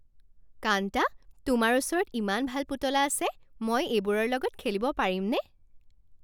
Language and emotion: Assamese, happy